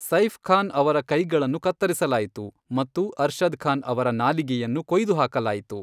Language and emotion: Kannada, neutral